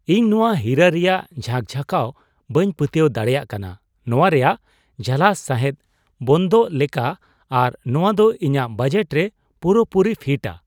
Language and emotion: Santali, surprised